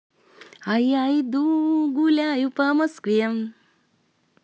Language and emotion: Russian, positive